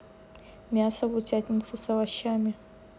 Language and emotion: Russian, neutral